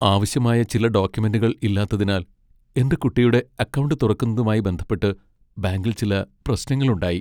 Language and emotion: Malayalam, sad